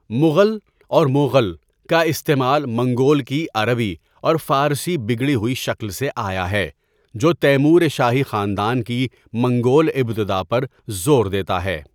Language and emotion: Urdu, neutral